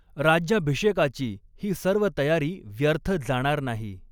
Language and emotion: Marathi, neutral